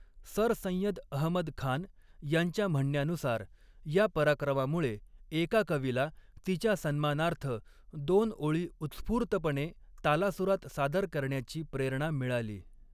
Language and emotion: Marathi, neutral